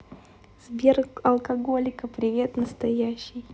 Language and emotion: Russian, positive